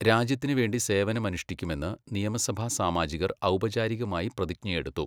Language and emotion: Malayalam, neutral